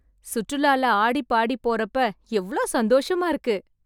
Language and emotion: Tamil, happy